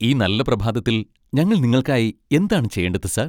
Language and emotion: Malayalam, happy